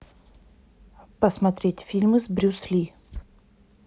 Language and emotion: Russian, neutral